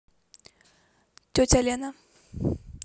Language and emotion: Russian, neutral